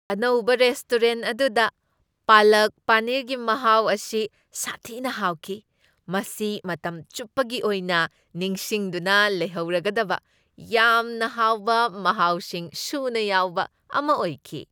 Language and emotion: Manipuri, happy